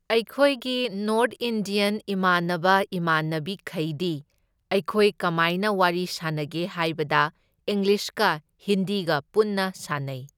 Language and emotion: Manipuri, neutral